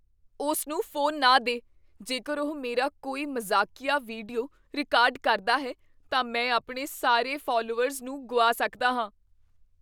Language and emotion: Punjabi, fearful